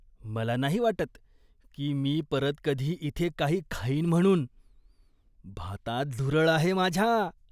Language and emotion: Marathi, disgusted